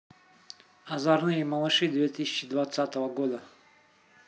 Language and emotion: Russian, neutral